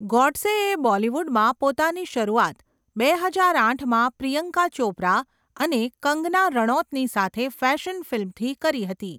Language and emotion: Gujarati, neutral